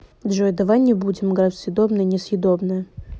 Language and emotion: Russian, neutral